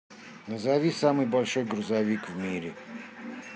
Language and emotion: Russian, neutral